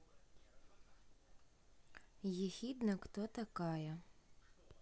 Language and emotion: Russian, neutral